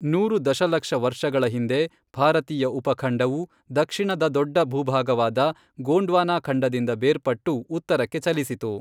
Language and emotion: Kannada, neutral